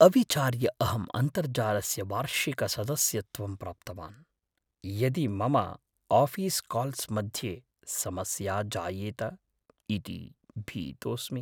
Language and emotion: Sanskrit, fearful